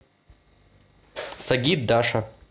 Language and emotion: Russian, neutral